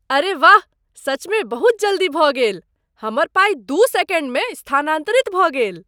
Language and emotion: Maithili, surprised